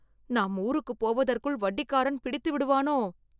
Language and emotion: Tamil, fearful